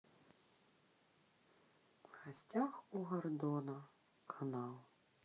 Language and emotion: Russian, sad